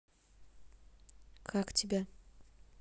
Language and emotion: Russian, neutral